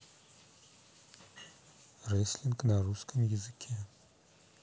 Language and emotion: Russian, neutral